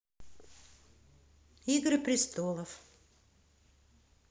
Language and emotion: Russian, neutral